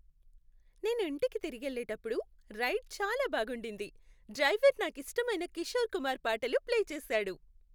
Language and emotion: Telugu, happy